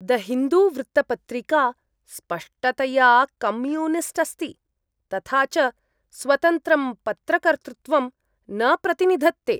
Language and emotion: Sanskrit, disgusted